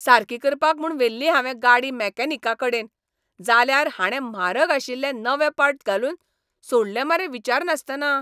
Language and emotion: Goan Konkani, angry